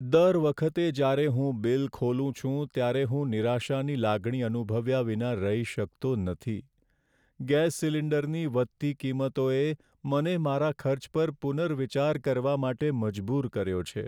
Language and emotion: Gujarati, sad